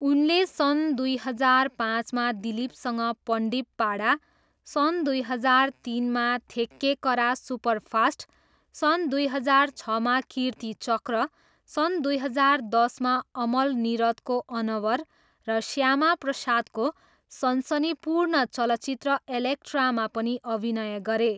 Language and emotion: Nepali, neutral